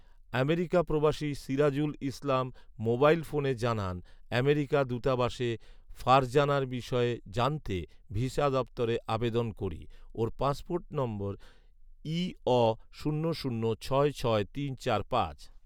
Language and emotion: Bengali, neutral